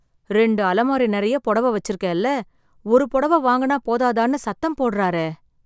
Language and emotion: Tamil, sad